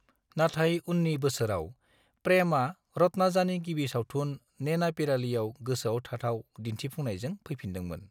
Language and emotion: Bodo, neutral